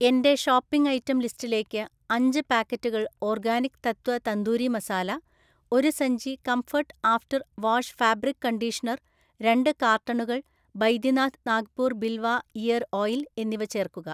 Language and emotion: Malayalam, neutral